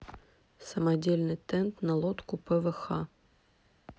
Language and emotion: Russian, neutral